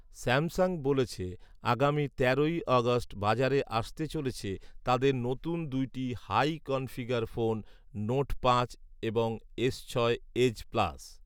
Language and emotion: Bengali, neutral